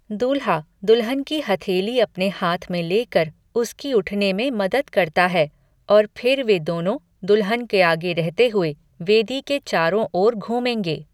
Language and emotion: Hindi, neutral